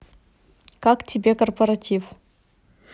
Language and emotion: Russian, neutral